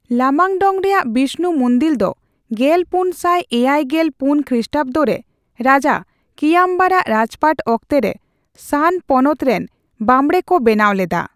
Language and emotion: Santali, neutral